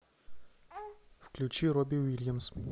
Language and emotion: Russian, neutral